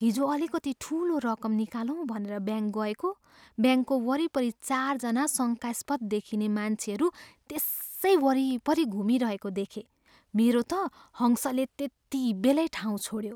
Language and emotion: Nepali, fearful